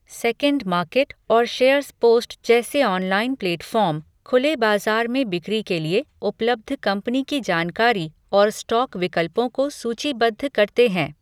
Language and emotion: Hindi, neutral